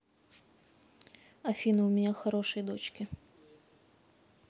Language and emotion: Russian, neutral